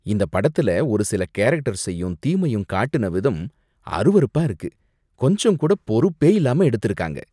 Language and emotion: Tamil, disgusted